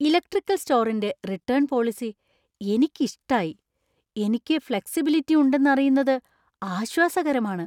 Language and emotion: Malayalam, surprised